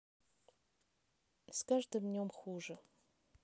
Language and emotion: Russian, neutral